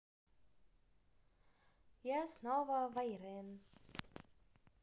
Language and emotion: Russian, positive